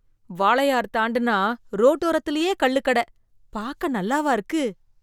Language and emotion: Tamil, disgusted